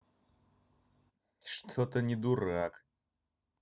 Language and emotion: Russian, angry